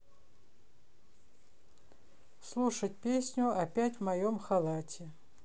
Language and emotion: Russian, neutral